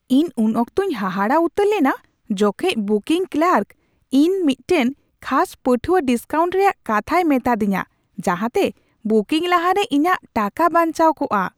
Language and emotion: Santali, surprised